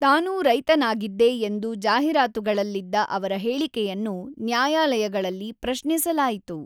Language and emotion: Kannada, neutral